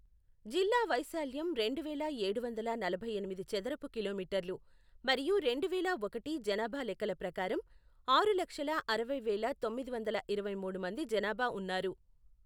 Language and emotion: Telugu, neutral